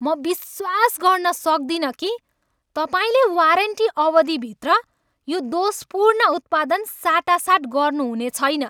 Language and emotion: Nepali, angry